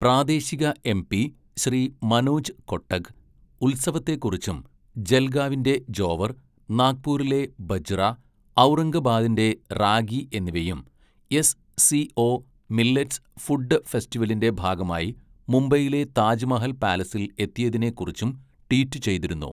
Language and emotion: Malayalam, neutral